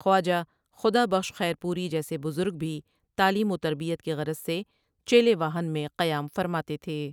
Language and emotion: Urdu, neutral